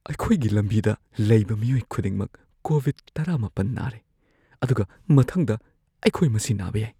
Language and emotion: Manipuri, fearful